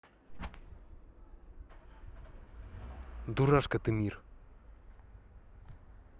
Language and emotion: Russian, angry